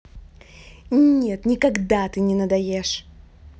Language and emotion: Russian, angry